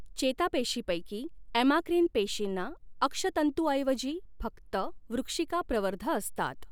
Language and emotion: Marathi, neutral